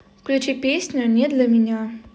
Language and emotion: Russian, neutral